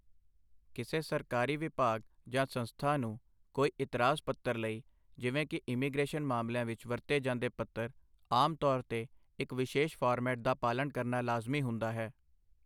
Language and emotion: Punjabi, neutral